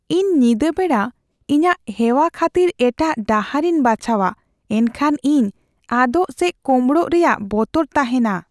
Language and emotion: Santali, fearful